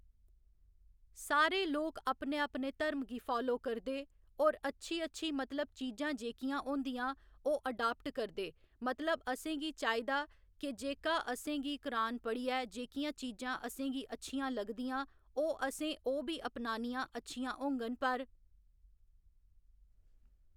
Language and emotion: Dogri, neutral